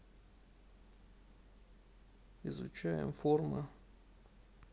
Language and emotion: Russian, sad